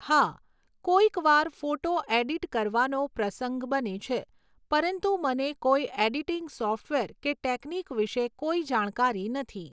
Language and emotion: Gujarati, neutral